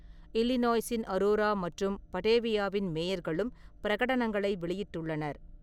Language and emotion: Tamil, neutral